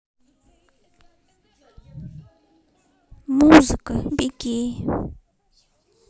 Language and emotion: Russian, sad